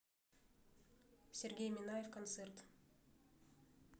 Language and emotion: Russian, neutral